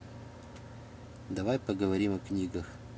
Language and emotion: Russian, neutral